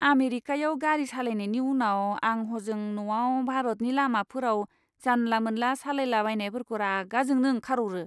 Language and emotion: Bodo, disgusted